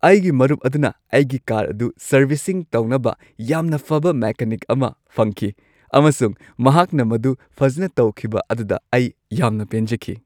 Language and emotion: Manipuri, happy